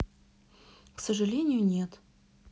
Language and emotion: Russian, neutral